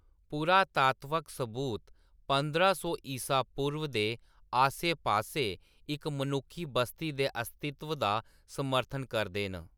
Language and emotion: Dogri, neutral